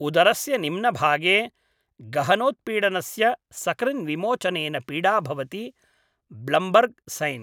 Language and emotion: Sanskrit, neutral